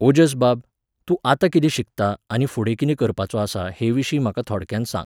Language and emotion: Goan Konkani, neutral